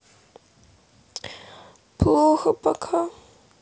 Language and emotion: Russian, sad